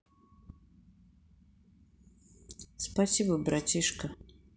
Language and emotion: Russian, neutral